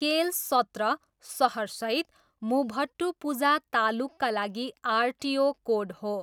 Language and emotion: Nepali, neutral